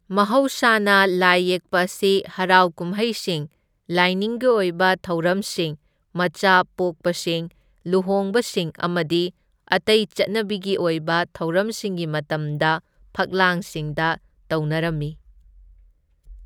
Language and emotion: Manipuri, neutral